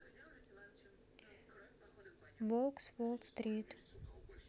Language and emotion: Russian, neutral